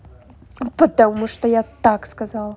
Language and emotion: Russian, angry